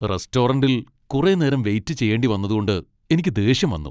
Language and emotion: Malayalam, angry